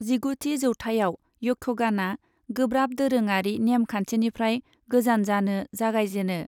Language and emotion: Bodo, neutral